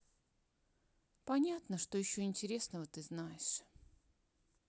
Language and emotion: Russian, sad